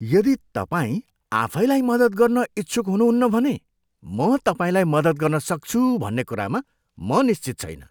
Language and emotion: Nepali, disgusted